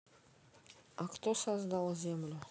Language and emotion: Russian, neutral